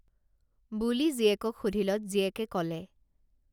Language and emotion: Assamese, neutral